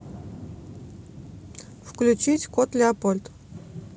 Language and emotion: Russian, neutral